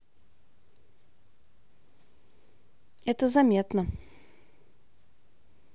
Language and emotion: Russian, neutral